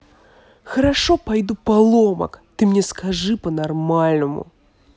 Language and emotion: Russian, angry